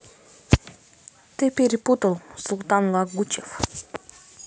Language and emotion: Russian, neutral